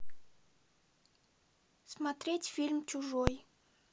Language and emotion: Russian, neutral